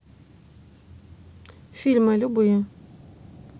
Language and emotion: Russian, neutral